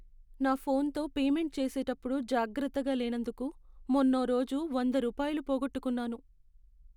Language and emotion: Telugu, sad